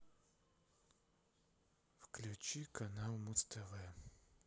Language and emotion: Russian, sad